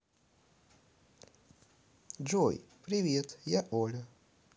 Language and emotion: Russian, positive